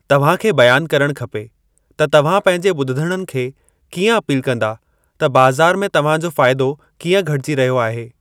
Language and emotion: Sindhi, neutral